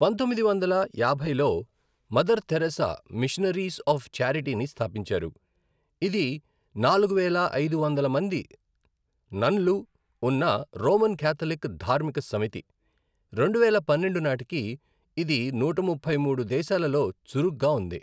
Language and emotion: Telugu, neutral